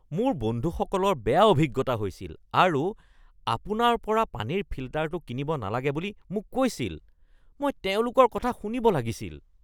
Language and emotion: Assamese, disgusted